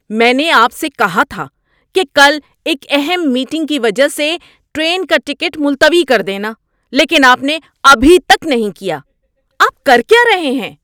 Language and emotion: Urdu, angry